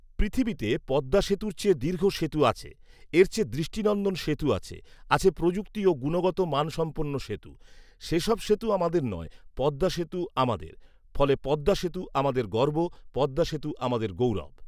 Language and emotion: Bengali, neutral